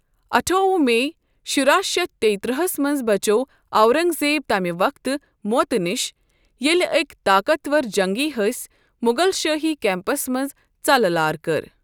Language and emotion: Kashmiri, neutral